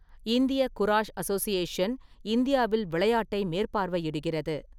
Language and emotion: Tamil, neutral